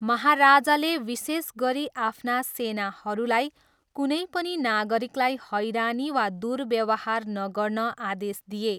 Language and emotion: Nepali, neutral